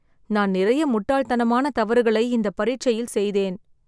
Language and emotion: Tamil, sad